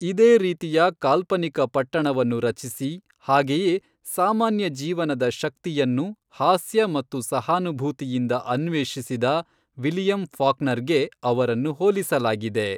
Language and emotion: Kannada, neutral